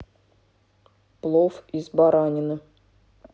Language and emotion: Russian, neutral